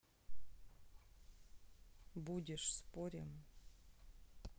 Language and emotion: Russian, neutral